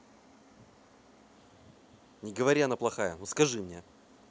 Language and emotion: Russian, angry